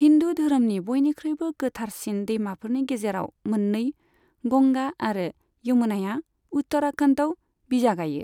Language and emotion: Bodo, neutral